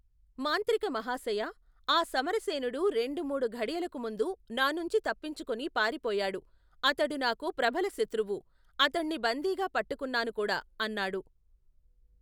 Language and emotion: Telugu, neutral